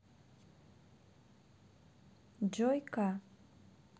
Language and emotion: Russian, neutral